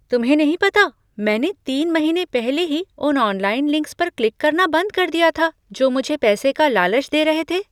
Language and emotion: Hindi, surprised